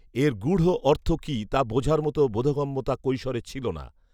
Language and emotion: Bengali, neutral